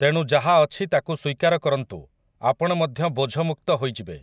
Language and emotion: Odia, neutral